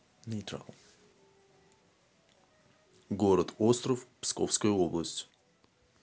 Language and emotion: Russian, neutral